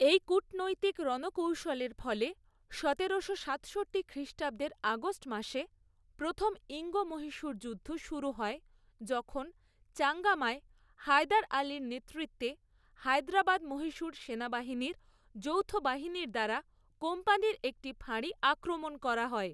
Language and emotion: Bengali, neutral